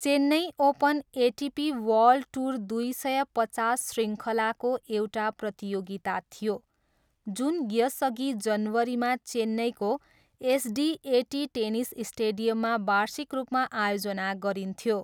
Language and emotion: Nepali, neutral